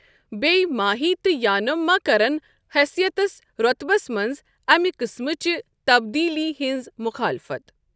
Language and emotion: Kashmiri, neutral